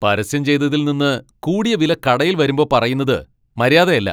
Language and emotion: Malayalam, angry